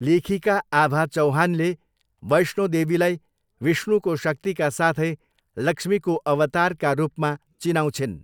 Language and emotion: Nepali, neutral